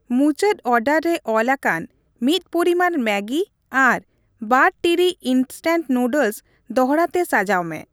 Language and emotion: Santali, neutral